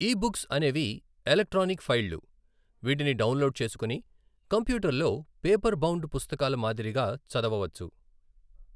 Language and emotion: Telugu, neutral